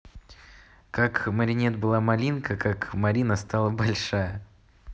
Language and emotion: Russian, positive